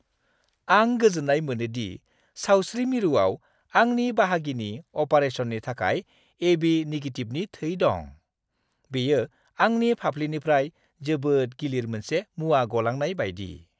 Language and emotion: Bodo, happy